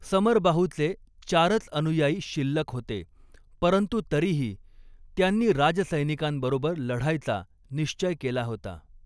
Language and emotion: Marathi, neutral